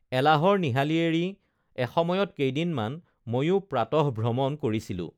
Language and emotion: Assamese, neutral